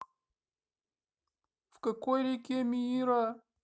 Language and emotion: Russian, sad